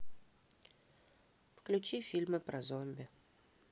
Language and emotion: Russian, neutral